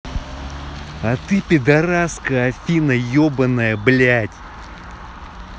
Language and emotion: Russian, angry